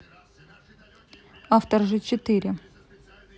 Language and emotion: Russian, neutral